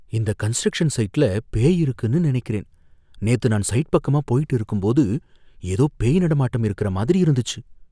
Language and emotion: Tamil, fearful